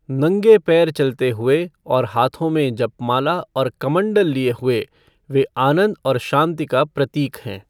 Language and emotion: Hindi, neutral